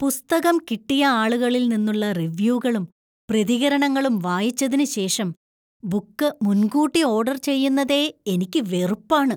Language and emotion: Malayalam, disgusted